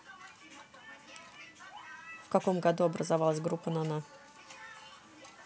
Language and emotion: Russian, neutral